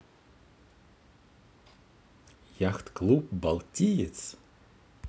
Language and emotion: Russian, positive